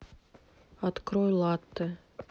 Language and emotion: Russian, neutral